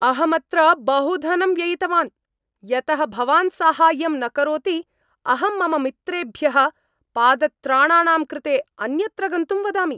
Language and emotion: Sanskrit, angry